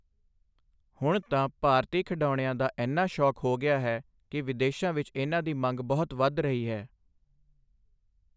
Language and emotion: Punjabi, neutral